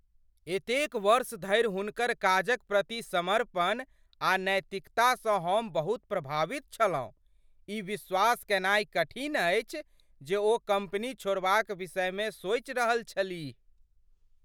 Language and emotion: Maithili, surprised